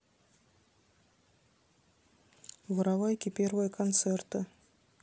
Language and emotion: Russian, neutral